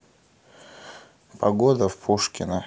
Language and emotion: Russian, neutral